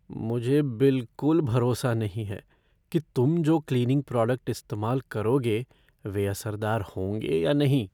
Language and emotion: Hindi, fearful